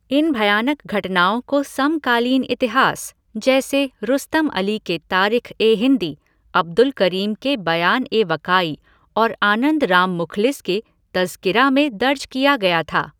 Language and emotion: Hindi, neutral